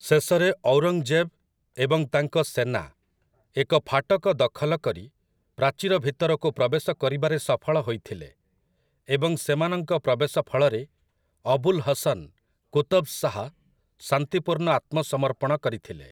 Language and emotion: Odia, neutral